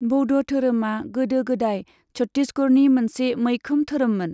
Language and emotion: Bodo, neutral